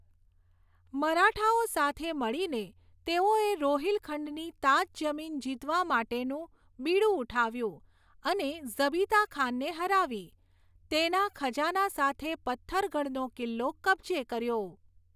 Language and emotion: Gujarati, neutral